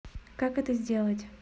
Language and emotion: Russian, neutral